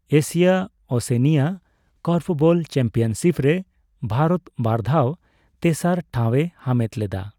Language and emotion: Santali, neutral